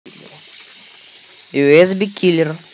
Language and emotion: Russian, neutral